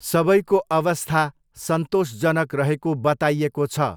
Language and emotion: Nepali, neutral